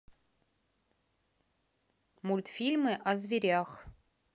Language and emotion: Russian, neutral